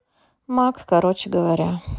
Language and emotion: Russian, sad